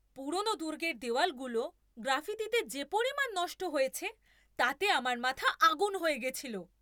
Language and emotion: Bengali, angry